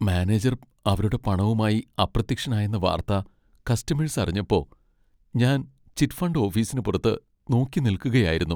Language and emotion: Malayalam, sad